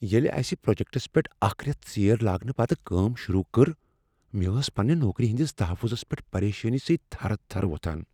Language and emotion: Kashmiri, fearful